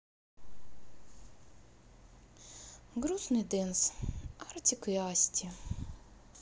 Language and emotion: Russian, sad